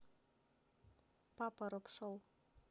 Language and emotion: Russian, neutral